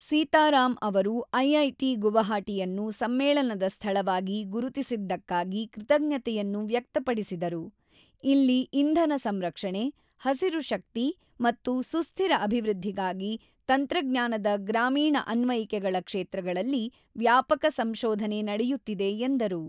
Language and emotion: Kannada, neutral